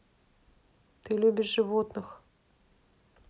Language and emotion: Russian, neutral